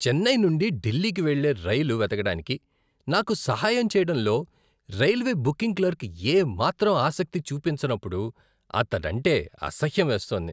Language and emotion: Telugu, disgusted